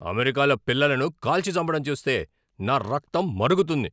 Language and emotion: Telugu, angry